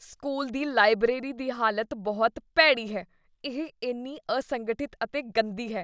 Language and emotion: Punjabi, disgusted